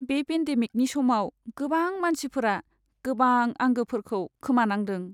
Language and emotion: Bodo, sad